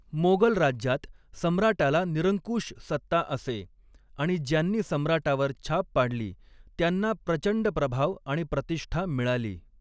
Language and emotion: Marathi, neutral